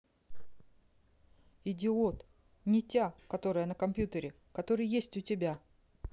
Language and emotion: Russian, neutral